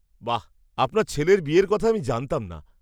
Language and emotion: Bengali, surprised